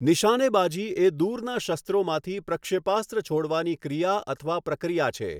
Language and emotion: Gujarati, neutral